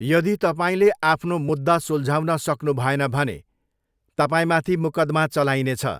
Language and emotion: Nepali, neutral